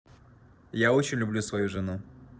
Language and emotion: Russian, neutral